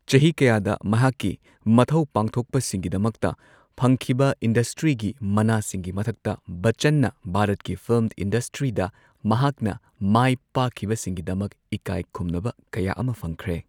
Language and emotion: Manipuri, neutral